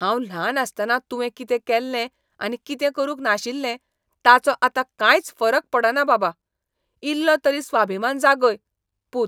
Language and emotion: Goan Konkani, disgusted